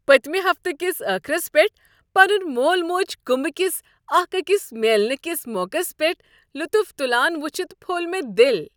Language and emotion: Kashmiri, happy